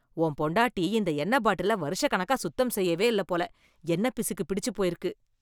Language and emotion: Tamil, disgusted